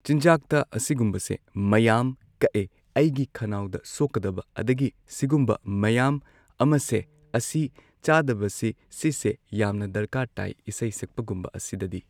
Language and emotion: Manipuri, neutral